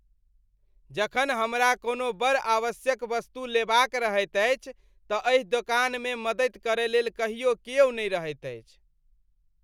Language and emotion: Maithili, disgusted